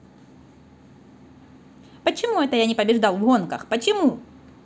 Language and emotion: Russian, neutral